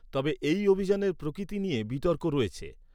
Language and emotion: Bengali, neutral